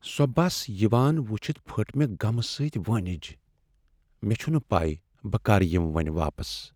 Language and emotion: Kashmiri, sad